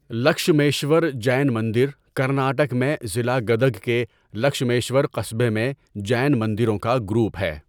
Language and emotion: Urdu, neutral